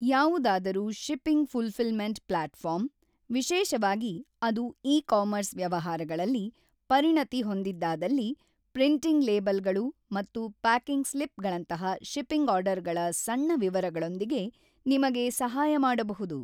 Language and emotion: Kannada, neutral